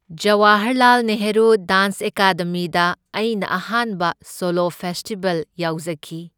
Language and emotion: Manipuri, neutral